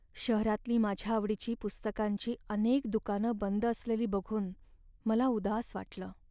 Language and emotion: Marathi, sad